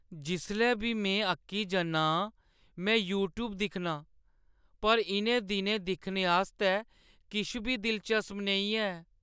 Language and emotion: Dogri, sad